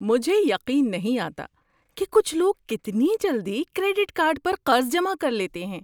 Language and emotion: Urdu, surprised